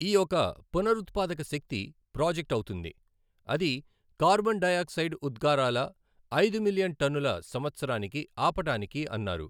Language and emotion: Telugu, neutral